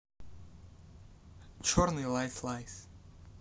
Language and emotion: Russian, neutral